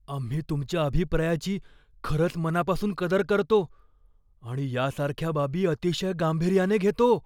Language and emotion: Marathi, fearful